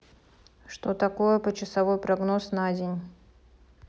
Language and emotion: Russian, neutral